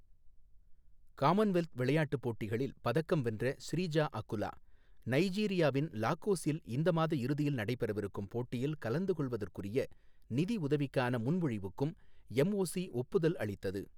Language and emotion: Tamil, neutral